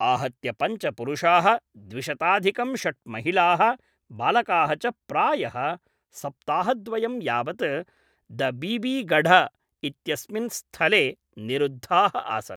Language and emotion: Sanskrit, neutral